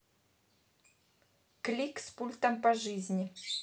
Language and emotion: Russian, neutral